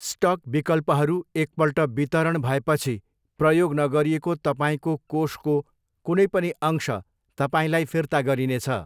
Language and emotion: Nepali, neutral